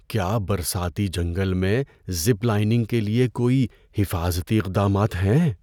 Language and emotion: Urdu, fearful